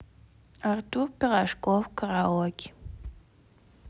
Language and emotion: Russian, neutral